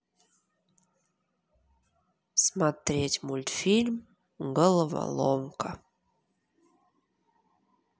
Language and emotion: Russian, neutral